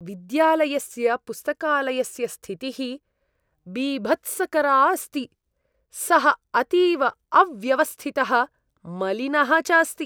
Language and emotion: Sanskrit, disgusted